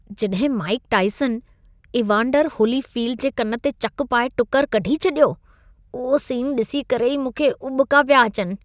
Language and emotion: Sindhi, disgusted